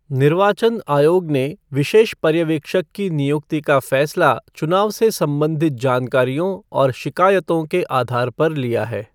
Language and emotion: Hindi, neutral